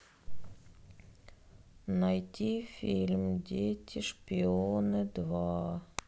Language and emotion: Russian, sad